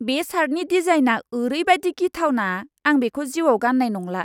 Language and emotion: Bodo, disgusted